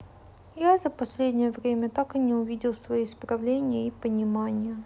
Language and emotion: Russian, sad